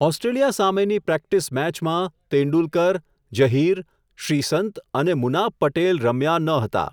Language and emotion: Gujarati, neutral